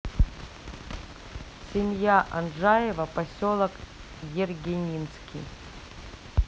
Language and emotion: Russian, neutral